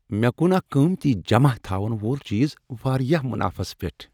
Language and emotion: Kashmiri, happy